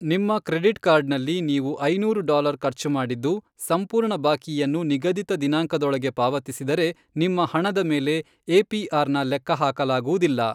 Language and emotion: Kannada, neutral